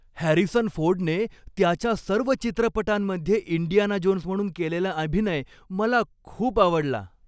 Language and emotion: Marathi, happy